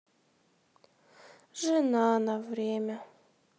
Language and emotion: Russian, sad